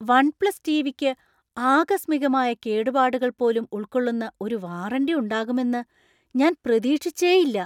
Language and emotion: Malayalam, surprised